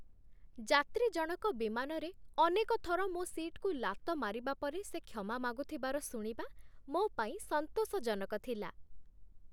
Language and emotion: Odia, happy